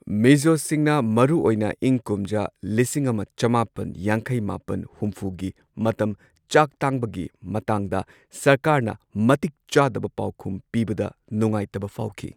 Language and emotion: Manipuri, neutral